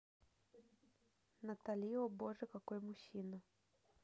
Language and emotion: Russian, neutral